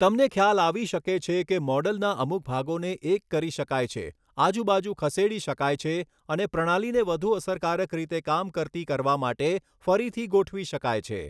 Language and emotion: Gujarati, neutral